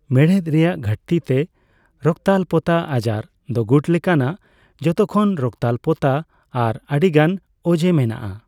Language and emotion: Santali, neutral